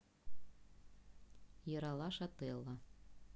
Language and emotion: Russian, neutral